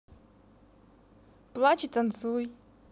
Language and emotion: Russian, positive